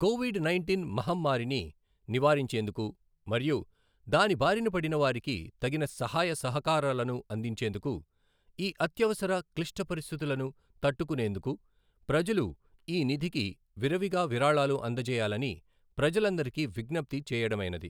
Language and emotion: Telugu, neutral